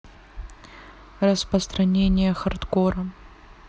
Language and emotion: Russian, neutral